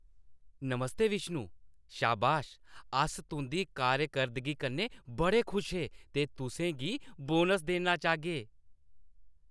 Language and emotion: Dogri, happy